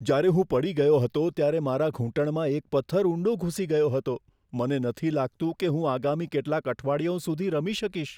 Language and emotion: Gujarati, fearful